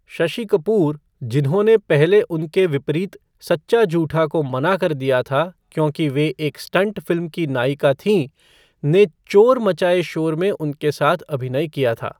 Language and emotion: Hindi, neutral